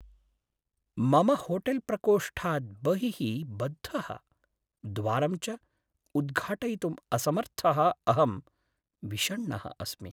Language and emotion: Sanskrit, sad